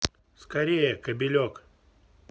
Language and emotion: Russian, neutral